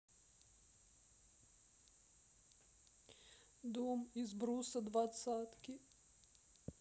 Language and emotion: Russian, sad